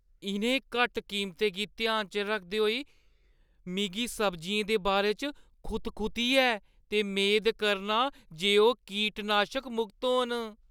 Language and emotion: Dogri, fearful